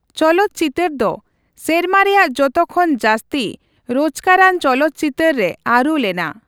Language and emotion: Santali, neutral